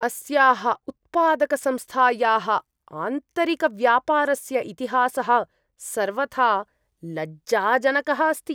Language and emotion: Sanskrit, disgusted